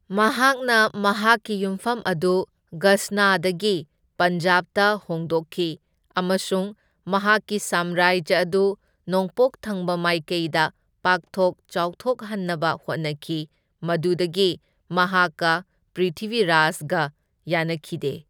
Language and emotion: Manipuri, neutral